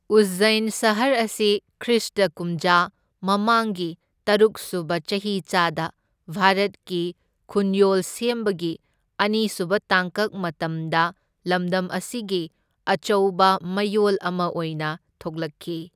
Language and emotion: Manipuri, neutral